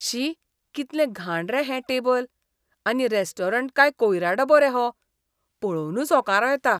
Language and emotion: Goan Konkani, disgusted